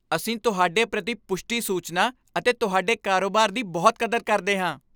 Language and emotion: Punjabi, happy